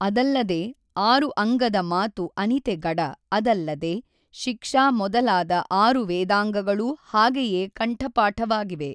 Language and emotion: Kannada, neutral